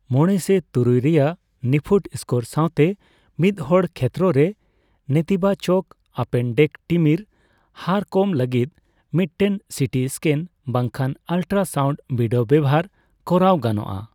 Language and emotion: Santali, neutral